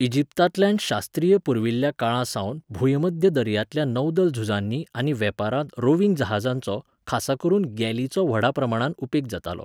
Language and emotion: Goan Konkani, neutral